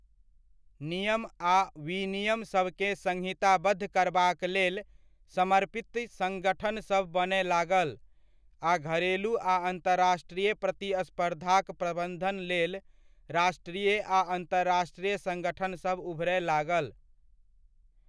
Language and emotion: Maithili, neutral